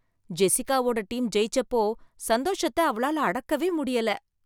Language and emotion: Tamil, happy